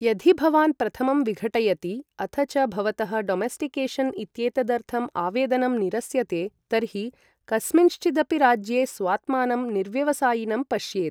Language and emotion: Sanskrit, neutral